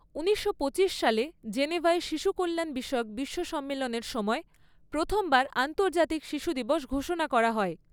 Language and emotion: Bengali, neutral